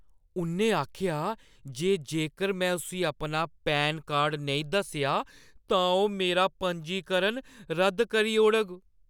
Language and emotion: Dogri, fearful